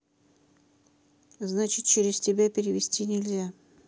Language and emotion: Russian, neutral